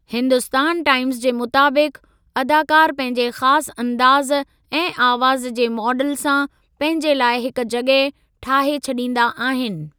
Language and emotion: Sindhi, neutral